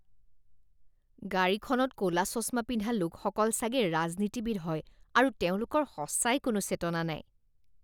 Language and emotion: Assamese, disgusted